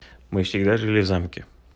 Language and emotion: Russian, neutral